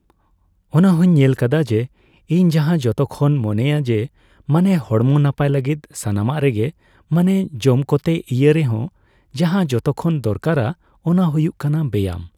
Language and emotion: Santali, neutral